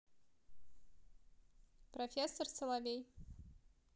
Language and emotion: Russian, neutral